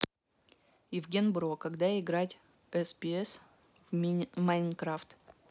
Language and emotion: Russian, neutral